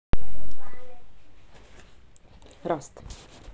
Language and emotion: Russian, neutral